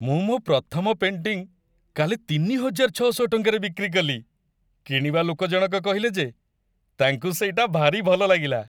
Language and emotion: Odia, happy